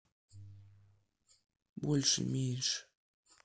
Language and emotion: Russian, neutral